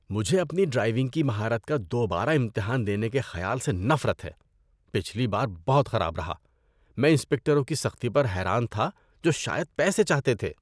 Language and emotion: Urdu, disgusted